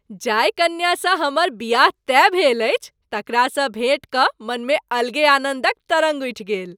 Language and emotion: Maithili, happy